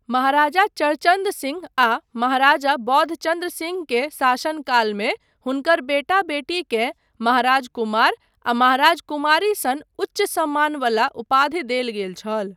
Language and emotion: Maithili, neutral